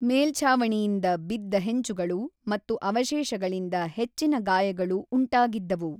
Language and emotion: Kannada, neutral